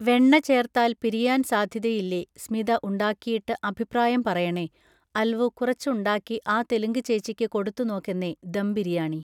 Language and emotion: Malayalam, neutral